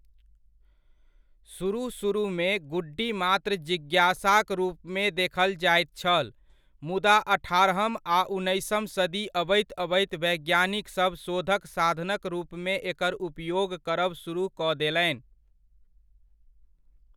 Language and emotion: Maithili, neutral